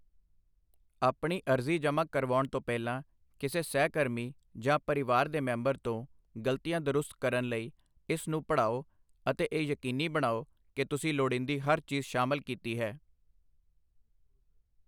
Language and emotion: Punjabi, neutral